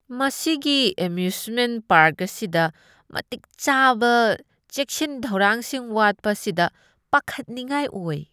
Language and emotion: Manipuri, disgusted